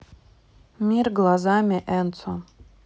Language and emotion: Russian, neutral